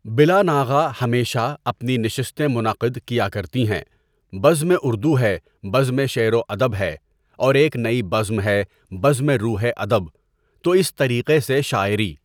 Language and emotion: Urdu, neutral